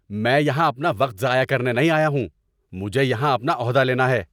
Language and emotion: Urdu, angry